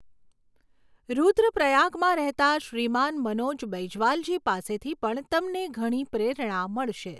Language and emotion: Gujarati, neutral